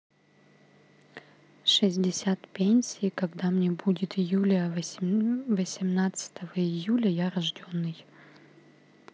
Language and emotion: Russian, neutral